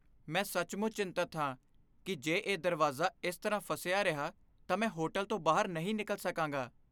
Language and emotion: Punjabi, fearful